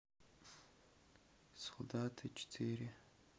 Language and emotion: Russian, neutral